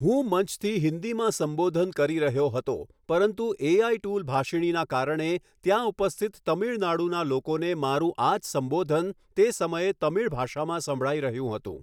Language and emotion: Gujarati, neutral